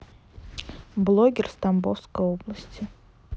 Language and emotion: Russian, neutral